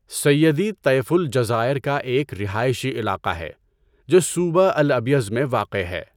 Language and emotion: Urdu, neutral